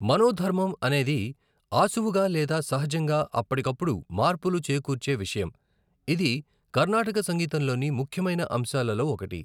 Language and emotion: Telugu, neutral